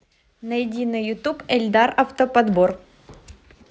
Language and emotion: Russian, positive